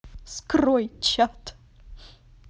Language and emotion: Russian, positive